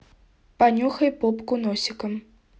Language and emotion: Russian, neutral